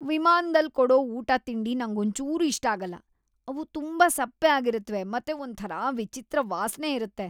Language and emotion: Kannada, disgusted